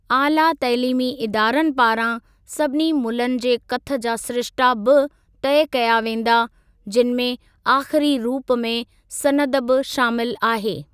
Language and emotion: Sindhi, neutral